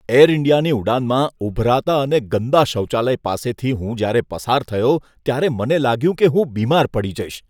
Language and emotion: Gujarati, disgusted